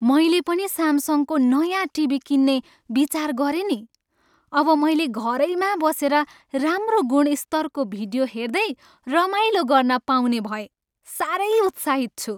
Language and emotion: Nepali, happy